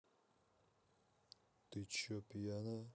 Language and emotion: Russian, neutral